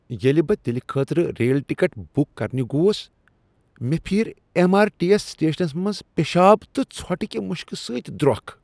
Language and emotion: Kashmiri, disgusted